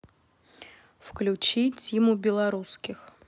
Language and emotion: Russian, neutral